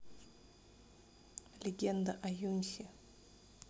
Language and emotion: Russian, neutral